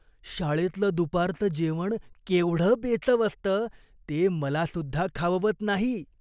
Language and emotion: Marathi, disgusted